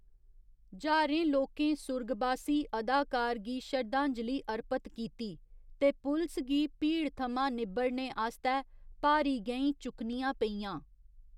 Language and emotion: Dogri, neutral